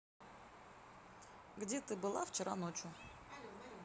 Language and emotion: Russian, neutral